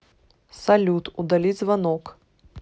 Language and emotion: Russian, neutral